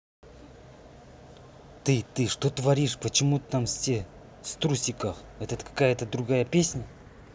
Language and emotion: Russian, angry